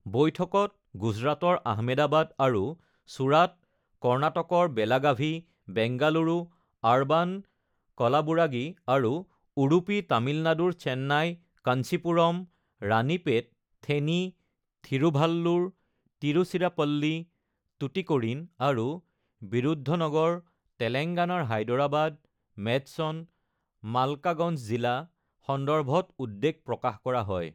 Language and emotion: Assamese, neutral